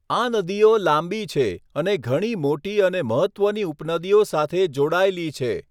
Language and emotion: Gujarati, neutral